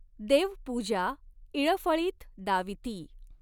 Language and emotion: Marathi, neutral